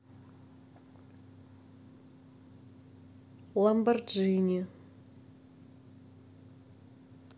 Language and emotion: Russian, neutral